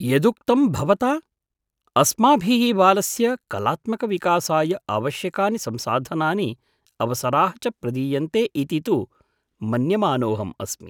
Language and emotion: Sanskrit, surprised